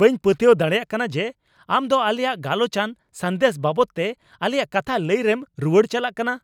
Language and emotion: Santali, angry